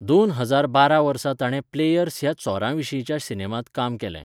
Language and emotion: Goan Konkani, neutral